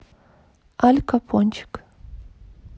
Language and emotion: Russian, neutral